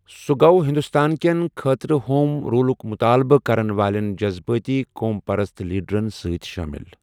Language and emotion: Kashmiri, neutral